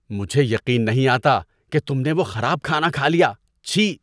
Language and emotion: Urdu, disgusted